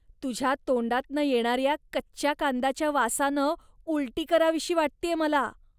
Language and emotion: Marathi, disgusted